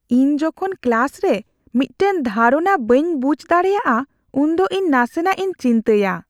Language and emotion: Santali, fearful